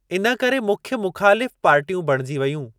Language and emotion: Sindhi, neutral